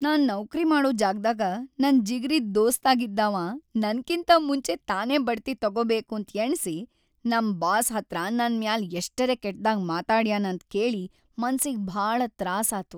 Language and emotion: Kannada, sad